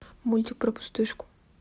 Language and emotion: Russian, neutral